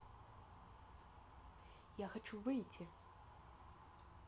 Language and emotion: Russian, neutral